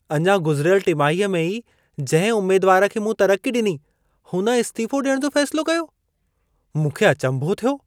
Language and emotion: Sindhi, surprised